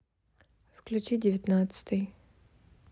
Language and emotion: Russian, neutral